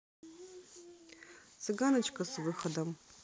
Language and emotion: Russian, neutral